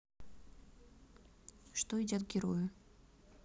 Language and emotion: Russian, neutral